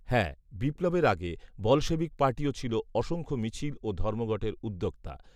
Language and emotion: Bengali, neutral